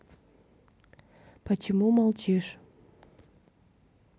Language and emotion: Russian, neutral